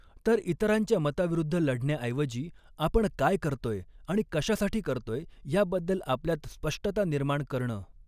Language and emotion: Marathi, neutral